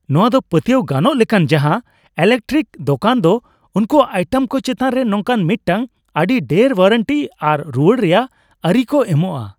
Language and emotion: Santali, happy